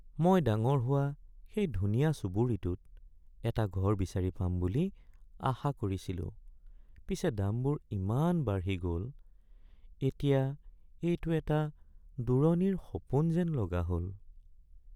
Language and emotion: Assamese, sad